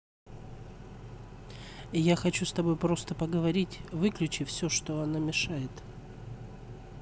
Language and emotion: Russian, neutral